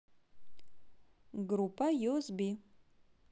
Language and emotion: Russian, positive